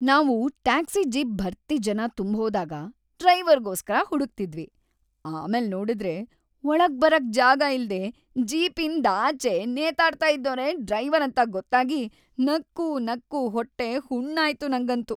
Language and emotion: Kannada, happy